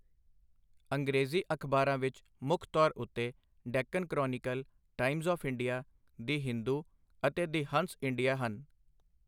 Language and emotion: Punjabi, neutral